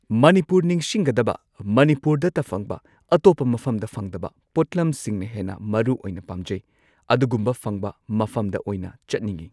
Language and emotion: Manipuri, neutral